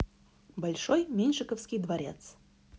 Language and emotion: Russian, positive